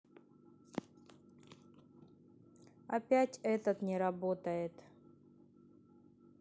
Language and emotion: Russian, neutral